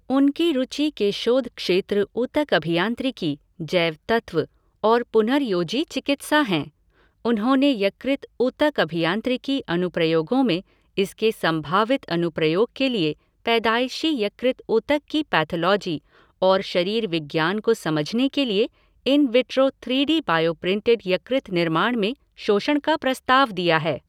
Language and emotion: Hindi, neutral